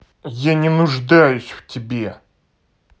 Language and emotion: Russian, angry